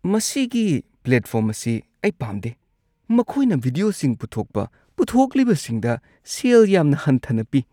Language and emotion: Manipuri, disgusted